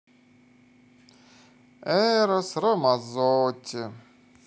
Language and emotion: Russian, positive